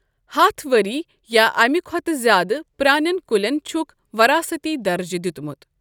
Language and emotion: Kashmiri, neutral